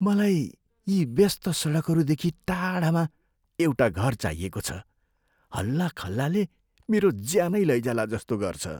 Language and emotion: Nepali, fearful